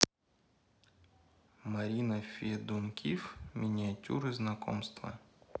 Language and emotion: Russian, neutral